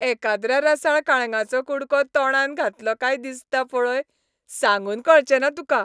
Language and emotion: Goan Konkani, happy